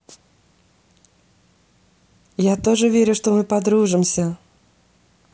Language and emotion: Russian, positive